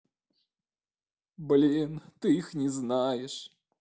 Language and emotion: Russian, sad